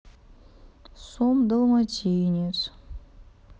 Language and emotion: Russian, sad